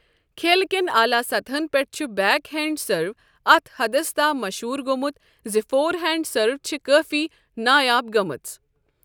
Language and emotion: Kashmiri, neutral